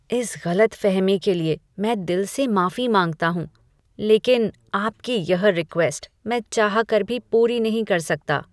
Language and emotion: Hindi, disgusted